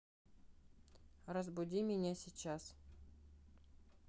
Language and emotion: Russian, neutral